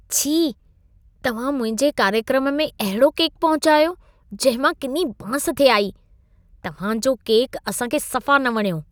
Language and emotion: Sindhi, disgusted